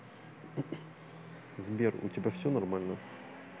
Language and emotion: Russian, neutral